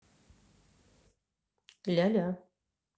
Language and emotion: Russian, neutral